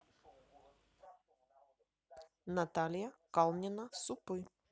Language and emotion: Russian, neutral